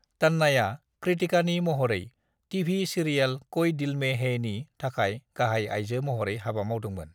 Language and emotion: Bodo, neutral